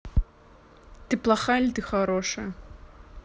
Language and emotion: Russian, neutral